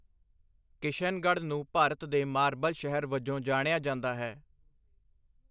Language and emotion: Punjabi, neutral